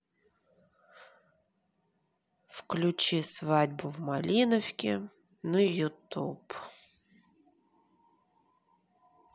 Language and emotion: Russian, neutral